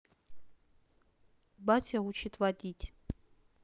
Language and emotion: Russian, neutral